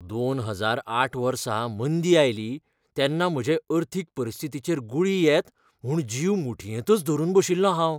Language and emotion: Goan Konkani, fearful